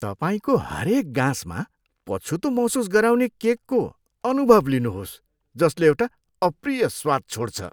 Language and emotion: Nepali, disgusted